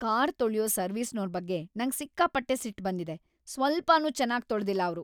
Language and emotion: Kannada, angry